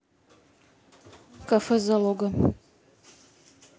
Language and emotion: Russian, neutral